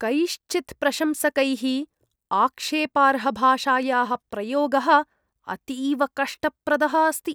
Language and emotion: Sanskrit, disgusted